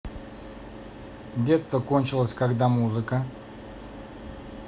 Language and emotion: Russian, neutral